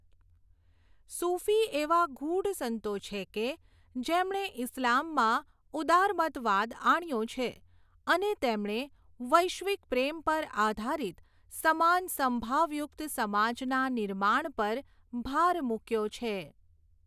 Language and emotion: Gujarati, neutral